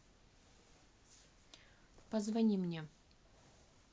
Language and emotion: Russian, neutral